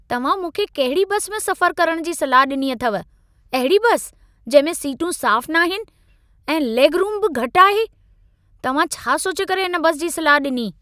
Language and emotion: Sindhi, angry